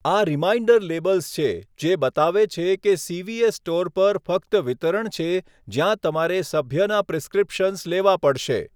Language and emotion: Gujarati, neutral